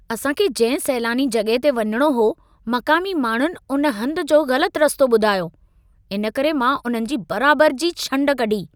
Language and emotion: Sindhi, angry